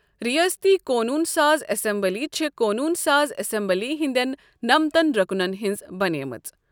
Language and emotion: Kashmiri, neutral